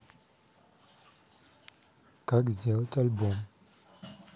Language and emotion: Russian, neutral